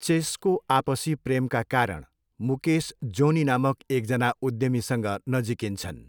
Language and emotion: Nepali, neutral